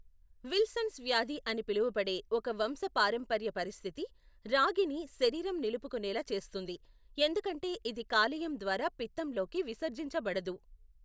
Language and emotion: Telugu, neutral